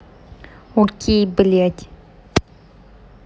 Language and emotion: Russian, angry